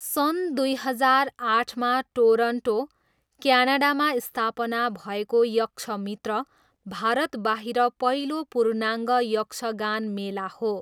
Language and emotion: Nepali, neutral